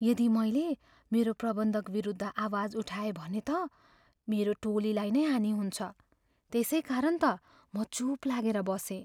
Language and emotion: Nepali, fearful